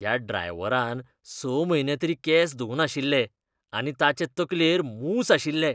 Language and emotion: Goan Konkani, disgusted